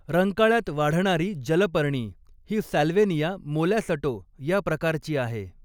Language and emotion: Marathi, neutral